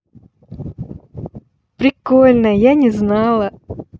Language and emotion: Russian, positive